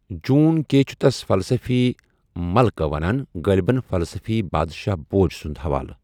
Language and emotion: Kashmiri, neutral